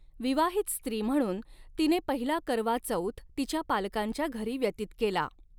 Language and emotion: Marathi, neutral